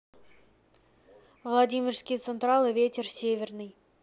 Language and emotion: Russian, neutral